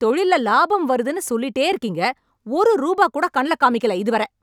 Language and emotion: Tamil, angry